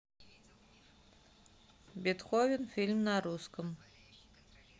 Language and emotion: Russian, neutral